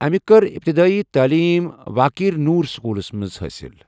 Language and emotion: Kashmiri, neutral